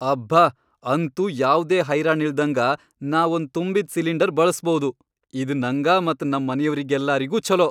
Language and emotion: Kannada, happy